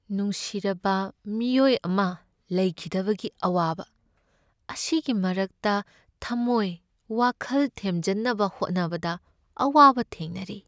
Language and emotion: Manipuri, sad